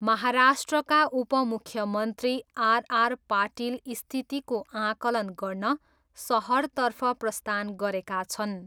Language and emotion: Nepali, neutral